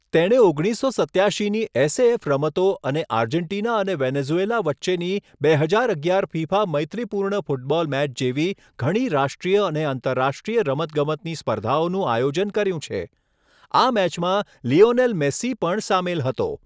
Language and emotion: Gujarati, neutral